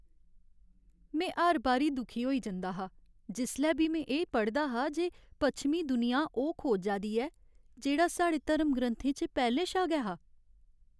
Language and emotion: Dogri, sad